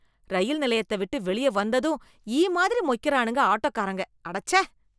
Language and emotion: Tamil, disgusted